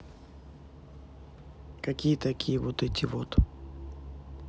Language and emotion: Russian, neutral